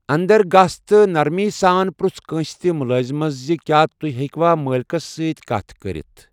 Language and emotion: Kashmiri, neutral